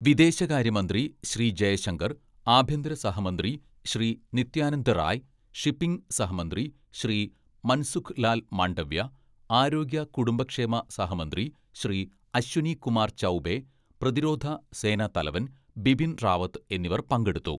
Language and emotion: Malayalam, neutral